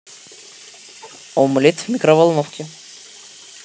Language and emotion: Russian, positive